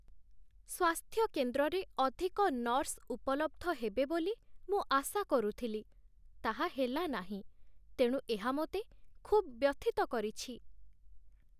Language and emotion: Odia, sad